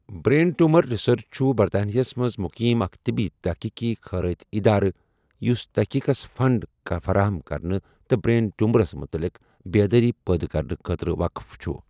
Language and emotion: Kashmiri, neutral